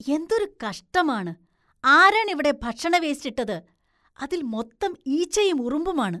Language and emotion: Malayalam, disgusted